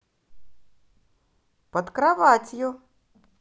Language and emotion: Russian, positive